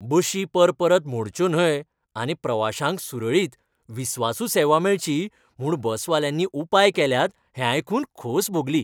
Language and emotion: Goan Konkani, happy